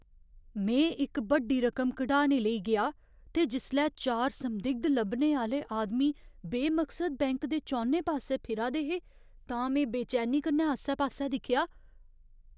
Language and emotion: Dogri, fearful